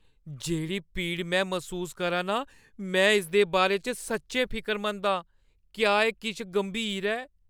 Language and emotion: Dogri, fearful